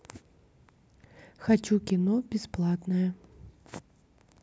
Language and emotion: Russian, neutral